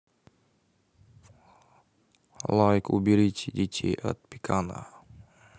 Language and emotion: Russian, neutral